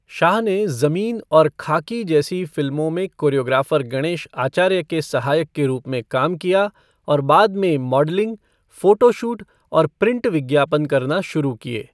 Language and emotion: Hindi, neutral